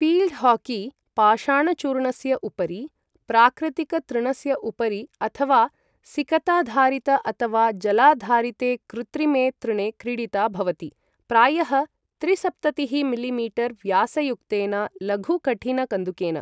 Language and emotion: Sanskrit, neutral